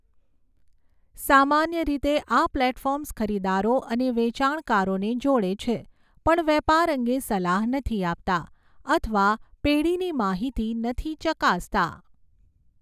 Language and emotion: Gujarati, neutral